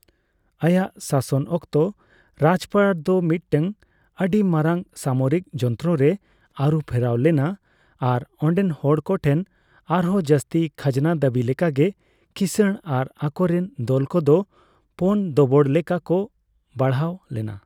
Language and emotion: Santali, neutral